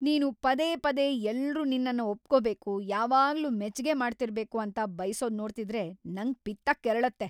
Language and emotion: Kannada, angry